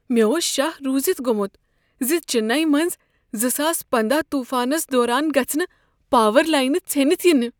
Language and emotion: Kashmiri, fearful